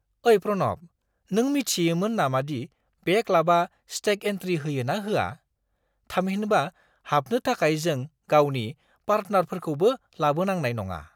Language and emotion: Bodo, surprised